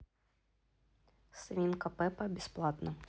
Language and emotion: Russian, neutral